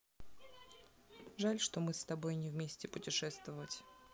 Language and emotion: Russian, neutral